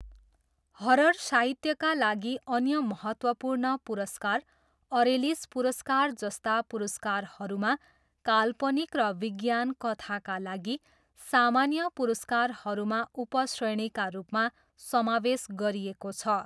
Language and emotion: Nepali, neutral